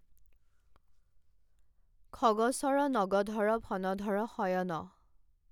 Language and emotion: Assamese, neutral